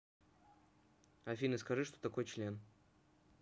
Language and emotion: Russian, neutral